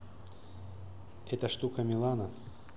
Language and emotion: Russian, neutral